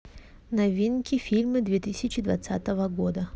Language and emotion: Russian, neutral